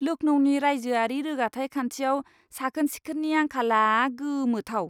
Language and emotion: Bodo, disgusted